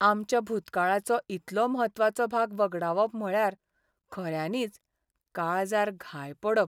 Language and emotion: Goan Konkani, sad